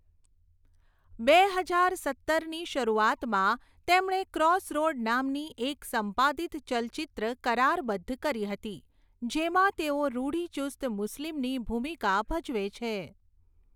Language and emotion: Gujarati, neutral